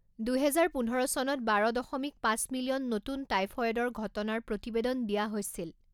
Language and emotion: Assamese, neutral